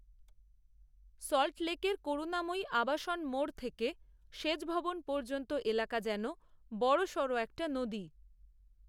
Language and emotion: Bengali, neutral